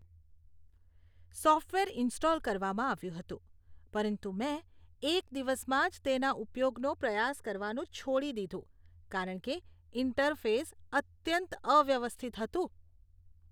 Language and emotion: Gujarati, disgusted